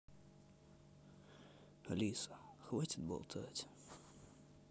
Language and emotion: Russian, sad